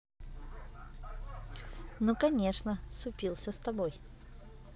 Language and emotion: Russian, positive